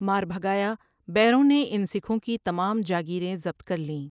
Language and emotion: Urdu, neutral